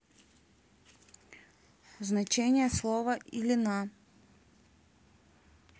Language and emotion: Russian, neutral